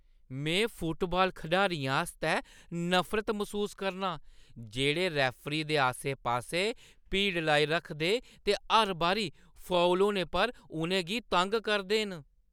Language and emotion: Dogri, disgusted